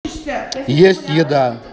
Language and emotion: Russian, neutral